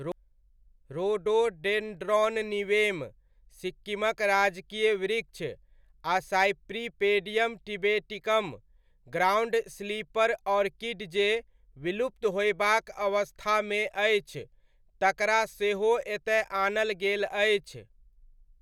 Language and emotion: Maithili, neutral